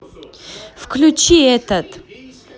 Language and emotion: Russian, positive